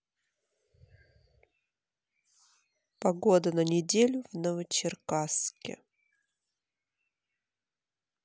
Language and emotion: Russian, neutral